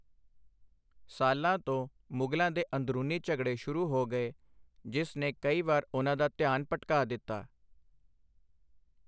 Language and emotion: Punjabi, neutral